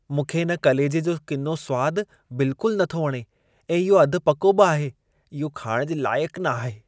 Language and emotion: Sindhi, disgusted